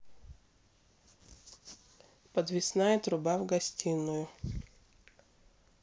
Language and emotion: Russian, neutral